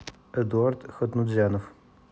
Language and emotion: Russian, neutral